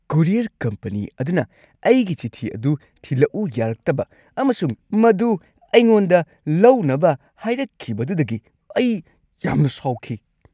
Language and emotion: Manipuri, angry